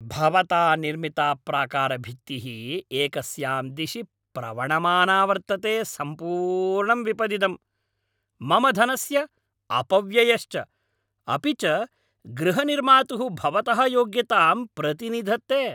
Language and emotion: Sanskrit, angry